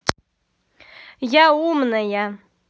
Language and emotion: Russian, angry